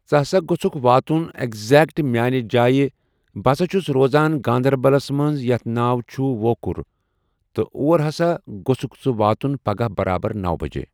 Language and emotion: Kashmiri, neutral